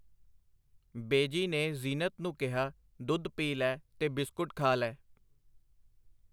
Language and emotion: Punjabi, neutral